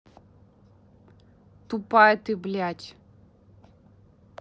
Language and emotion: Russian, angry